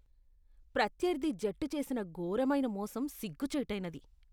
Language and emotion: Telugu, disgusted